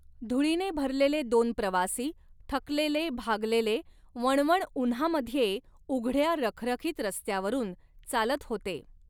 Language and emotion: Marathi, neutral